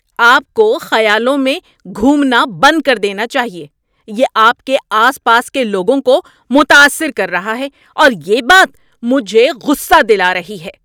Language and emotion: Urdu, angry